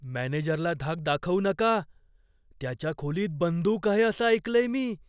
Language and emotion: Marathi, fearful